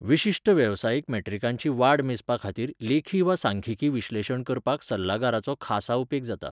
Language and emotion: Goan Konkani, neutral